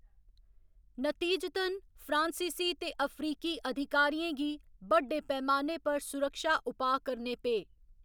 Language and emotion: Dogri, neutral